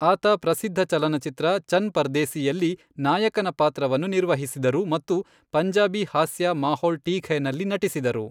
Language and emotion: Kannada, neutral